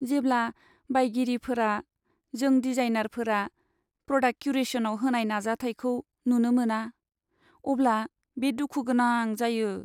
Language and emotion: Bodo, sad